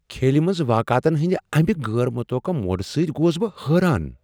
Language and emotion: Kashmiri, surprised